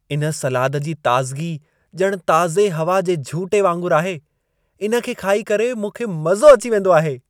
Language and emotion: Sindhi, happy